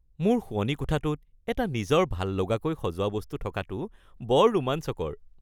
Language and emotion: Assamese, happy